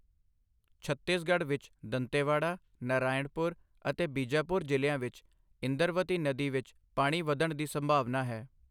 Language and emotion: Punjabi, neutral